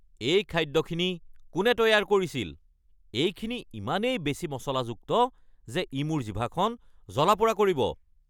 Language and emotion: Assamese, angry